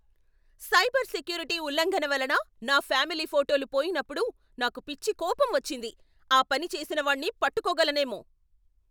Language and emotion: Telugu, angry